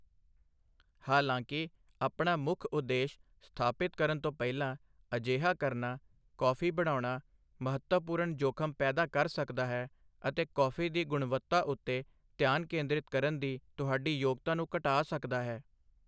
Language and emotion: Punjabi, neutral